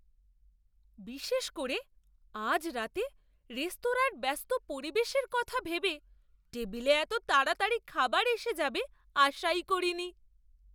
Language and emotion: Bengali, surprised